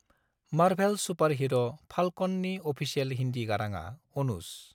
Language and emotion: Bodo, neutral